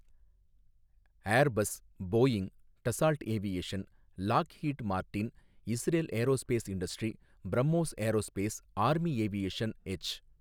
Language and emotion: Tamil, neutral